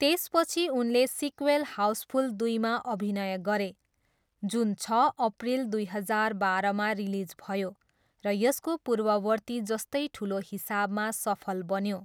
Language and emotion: Nepali, neutral